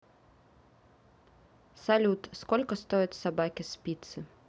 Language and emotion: Russian, neutral